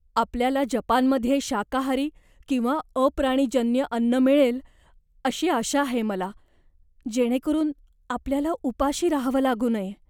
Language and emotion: Marathi, fearful